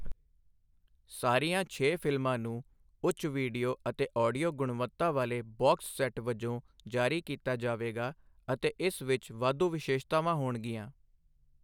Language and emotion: Punjabi, neutral